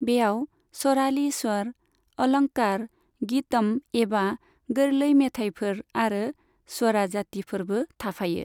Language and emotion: Bodo, neutral